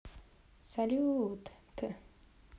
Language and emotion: Russian, positive